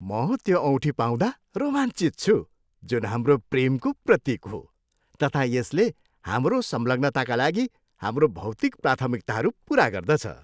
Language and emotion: Nepali, happy